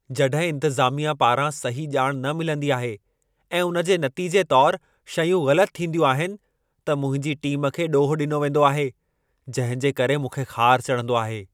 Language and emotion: Sindhi, angry